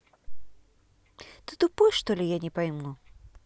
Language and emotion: Russian, angry